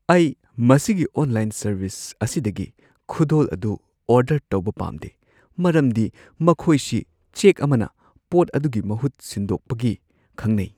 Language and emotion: Manipuri, fearful